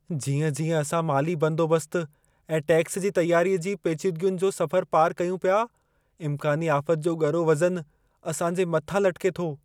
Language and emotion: Sindhi, fearful